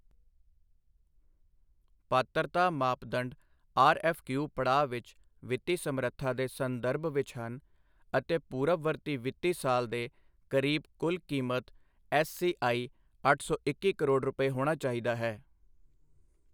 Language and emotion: Punjabi, neutral